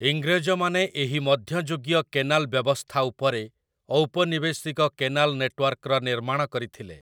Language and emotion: Odia, neutral